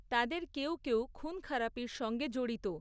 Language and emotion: Bengali, neutral